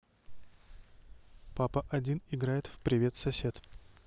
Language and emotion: Russian, neutral